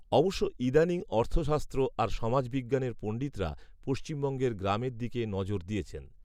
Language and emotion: Bengali, neutral